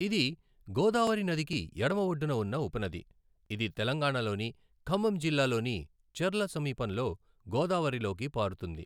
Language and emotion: Telugu, neutral